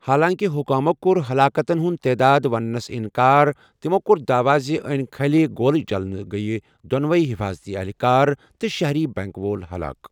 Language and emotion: Kashmiri, neutral